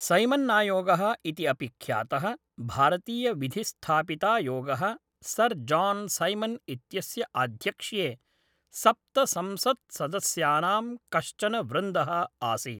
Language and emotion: Sanskrit, neutral